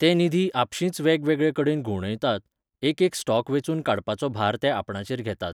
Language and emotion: Goan Konkani, neutral